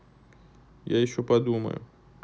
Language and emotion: Russian, neutral